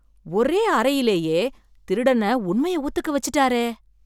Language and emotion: Tamil, surprised